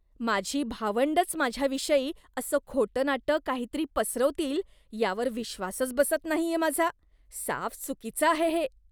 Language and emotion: Marathi, disgusted